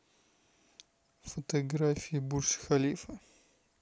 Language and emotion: Russian, neutral